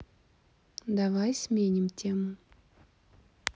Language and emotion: Russian, neutral